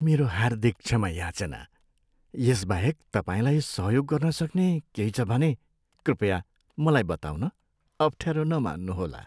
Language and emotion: Nepali, sad